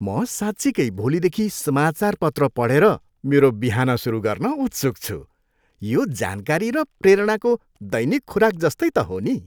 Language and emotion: Nepali, happy